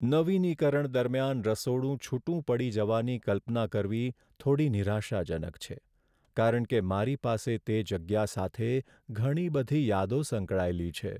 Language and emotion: Gujarati, sad